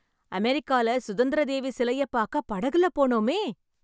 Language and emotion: Tamil, happy